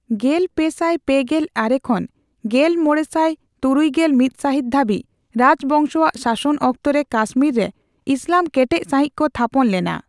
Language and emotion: Santali, neutral